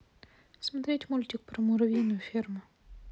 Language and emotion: Russian, neutral